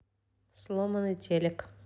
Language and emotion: Russian, neutral